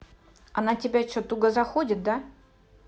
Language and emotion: Russian, angry